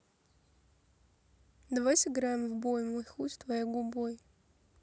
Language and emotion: Russian, neutral